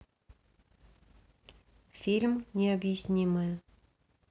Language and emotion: Russian, neutral